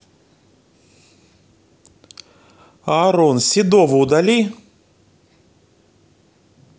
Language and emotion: Russian, neutral